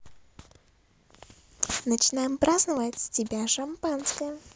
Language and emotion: Russian, positive